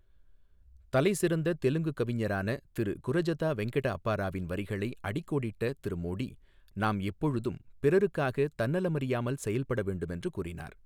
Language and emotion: Tamil, neutral